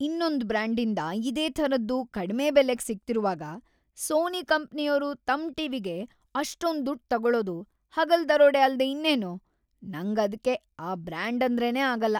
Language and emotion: Kannada, disgusted